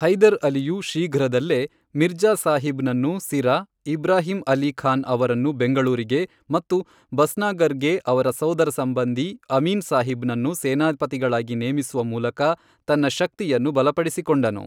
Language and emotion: Kannada, neutral